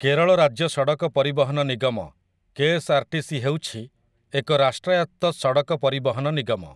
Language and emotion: Odia, neutral